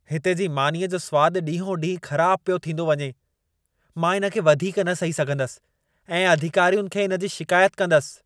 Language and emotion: Sindhi, angry